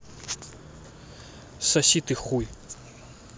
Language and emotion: Russian, angry